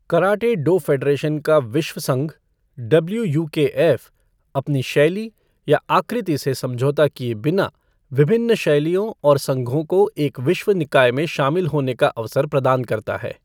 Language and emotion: Hindi, neutral